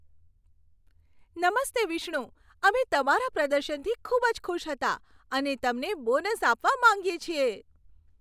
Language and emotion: Gujarati, happy